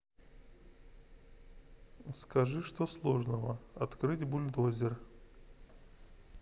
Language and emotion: Russian, neutral